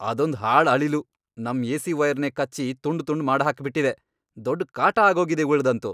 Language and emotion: Kannada, angry